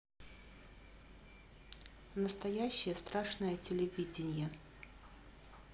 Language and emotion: Russian, neutral